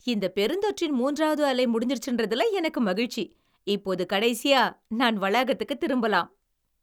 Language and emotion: Tamil, happy